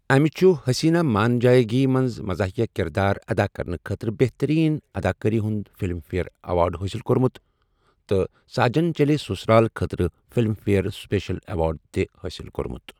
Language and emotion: Kashmiri, neutral